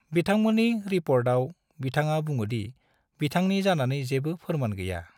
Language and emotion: Bodo, neutral